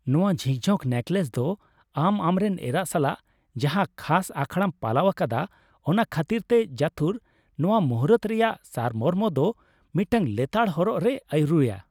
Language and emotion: Santali, happy